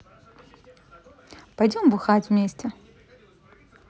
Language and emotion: Russian, positive